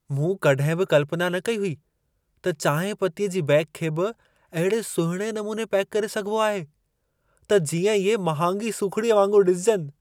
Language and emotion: Sindhi, surprised